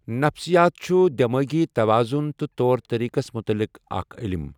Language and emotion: Kashmiri, neutral